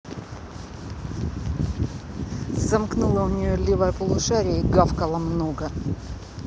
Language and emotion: Russian, angry